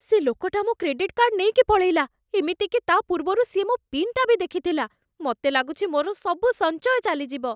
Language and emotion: Odia, fearful